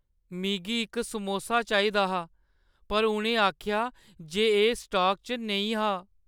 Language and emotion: Dogri, sad